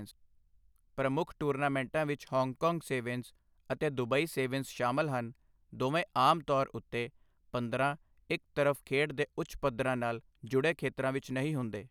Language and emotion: Punjabi, neutral